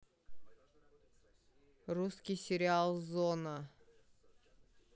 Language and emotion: Russian, neutral